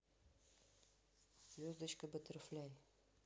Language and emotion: Russian, neutral